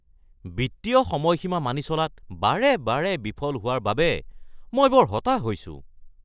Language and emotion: Assamese, angry